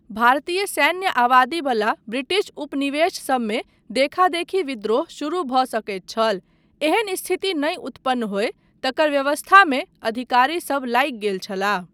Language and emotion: Maithili, neutral